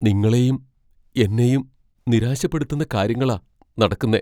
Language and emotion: Malayalam, fearful